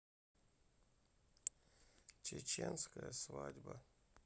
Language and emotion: Russian, sad